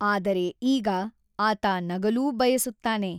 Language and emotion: Kannada, neutral